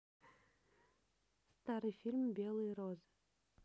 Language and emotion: Russian, neutral